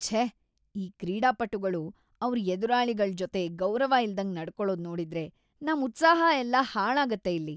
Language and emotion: Kannada, disgusted